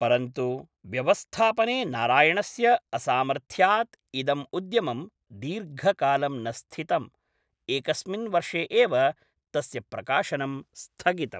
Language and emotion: Sanskrit, neutral